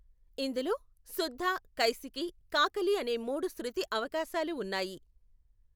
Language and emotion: Telugu, neutral